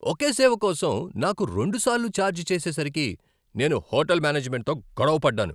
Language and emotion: Telugu, angry